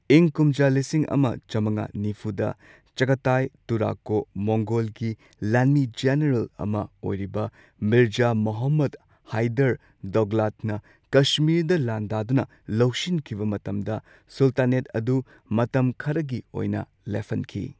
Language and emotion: Manipuri, neutral